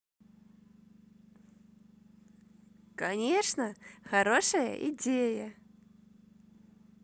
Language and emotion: Russian, positive